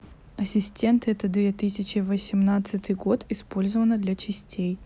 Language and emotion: Russian, neutral